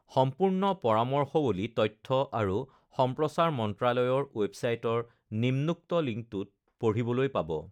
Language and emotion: Assamese, neutral